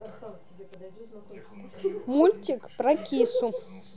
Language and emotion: Russian, neutral